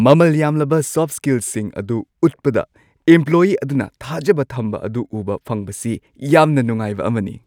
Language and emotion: Manipuri, happy